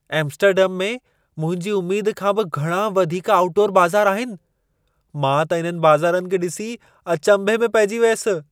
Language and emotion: Sindhi, surprised